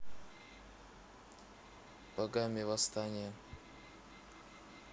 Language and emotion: Russian, neutral